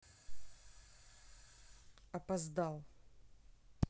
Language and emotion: Russian, angry